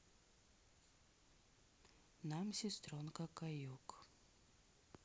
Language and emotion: Russian, sad